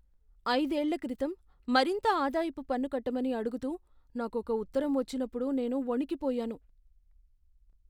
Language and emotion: Telugu, fearful